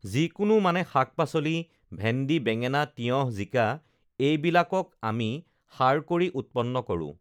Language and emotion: Assamese, neutral